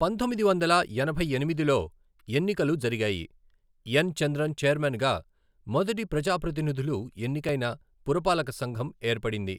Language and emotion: Telugu, neutral